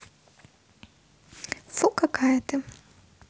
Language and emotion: Russian, neutral